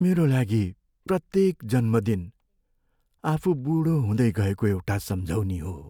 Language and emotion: Nepali, sad